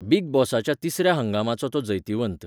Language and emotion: Goan Konkani, neutral